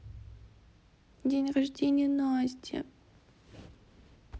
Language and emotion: Russian, sad